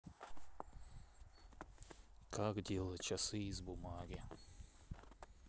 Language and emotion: Russian, neutral